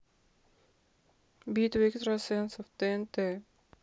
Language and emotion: Russian, neutral